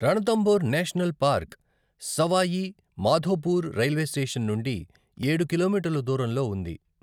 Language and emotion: Telugu, neutral